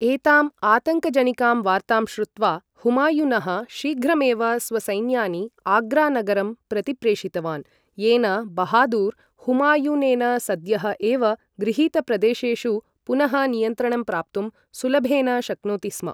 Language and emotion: Sanskrit, neutral